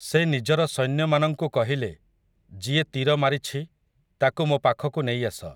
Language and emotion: Odia, neutral